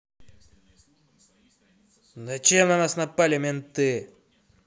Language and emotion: Russian, angry